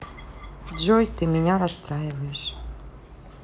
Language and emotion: Russian, sad